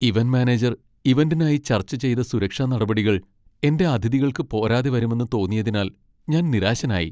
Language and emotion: Malayalam, sad